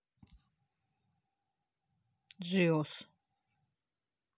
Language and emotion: Russian, neutral